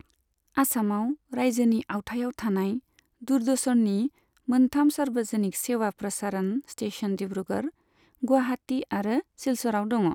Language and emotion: Bodo, neutral